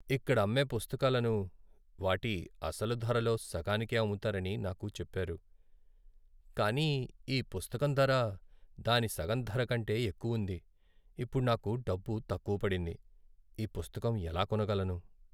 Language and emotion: Telugu, sad